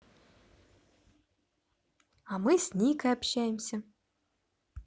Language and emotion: Russian, positive